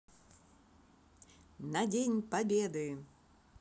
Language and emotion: Russian, positive